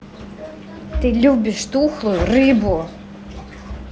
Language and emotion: Russian, angry